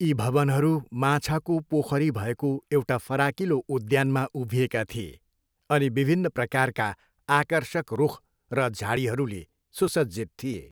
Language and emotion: Nepali, neutral